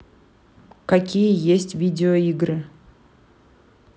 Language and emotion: Russian, neutral